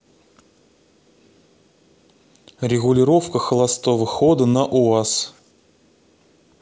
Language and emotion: Russian, neutral